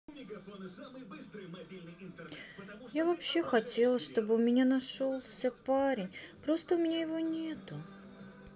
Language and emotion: Russian, sad